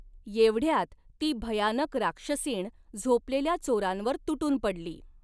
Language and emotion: Marathi, neutral